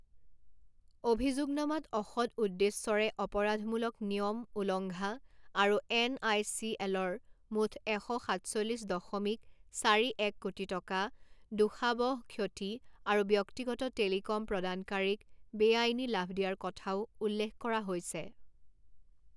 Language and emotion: Assamese, neutral